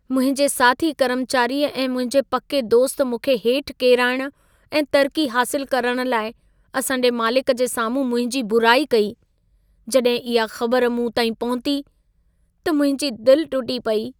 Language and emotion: Sindhi, sad